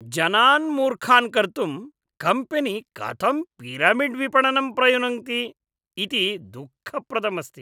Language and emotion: Sanskrit, disgusted